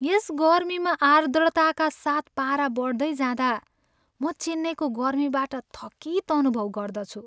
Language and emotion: Nepali, sad